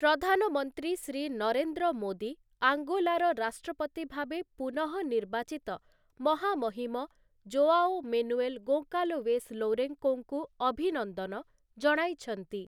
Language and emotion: Odia, neutral